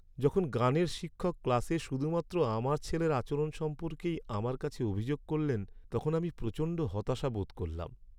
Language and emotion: Bengali, sad